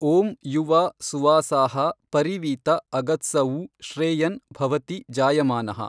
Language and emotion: Kannada, neutral